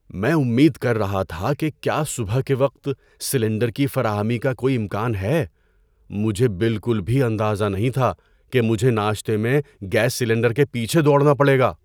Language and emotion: Urdu, surprised